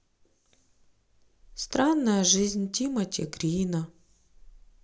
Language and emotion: Russian, sad